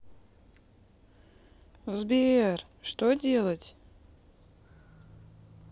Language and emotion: Russian, sad